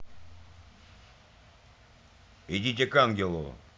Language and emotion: Russian, angry